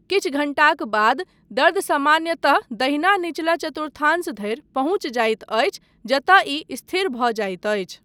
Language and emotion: Maithili, neutral